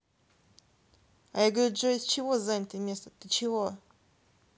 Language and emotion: Russian, neutral